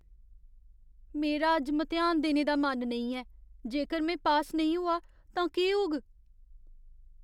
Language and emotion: Dogri, fearful